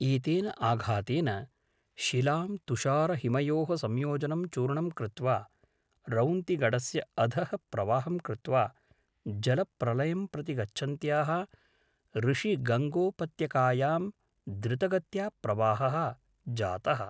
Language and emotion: Sanskrit, neutral